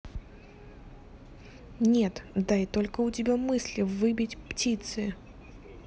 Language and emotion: Russian, neutral